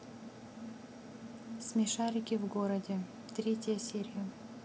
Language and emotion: Russian, neutral